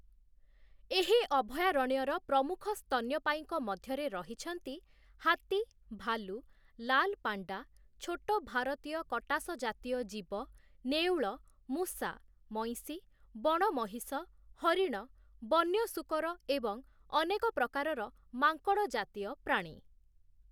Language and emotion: Odia, neutral